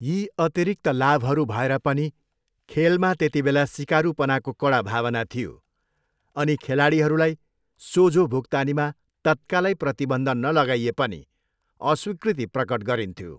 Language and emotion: Nepali, neutral